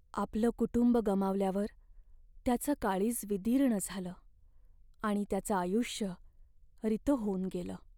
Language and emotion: Marathi, sad